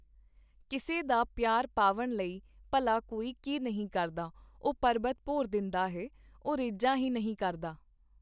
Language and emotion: Punjabi, neutral